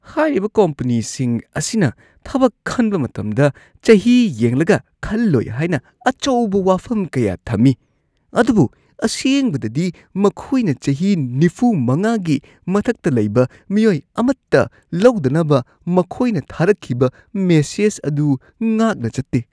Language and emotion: Manipuri, disgusted